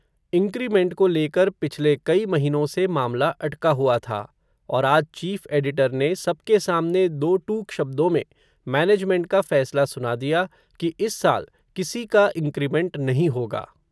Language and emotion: Hindi, neutral